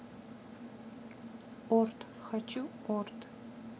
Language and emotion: Russian, neutral